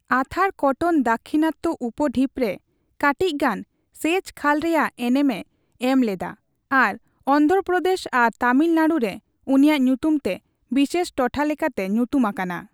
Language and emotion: Santali, neutral